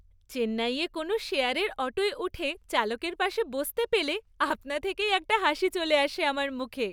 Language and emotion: Bengali, happy